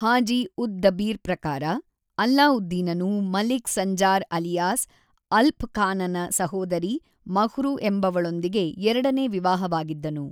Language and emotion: Kannada, neutral